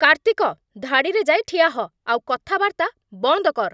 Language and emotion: Odia, angry